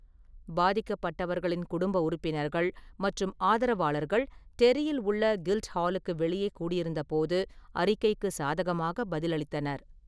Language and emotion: Tamil, neutral